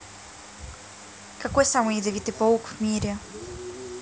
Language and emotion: Russian, neutral